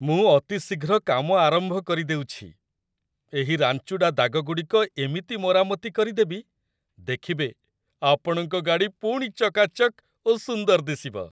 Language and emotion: Odia, happy